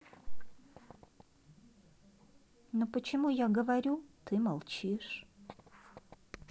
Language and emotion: Russian, sad